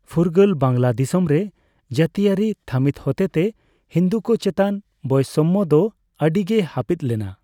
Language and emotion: Santali, neutral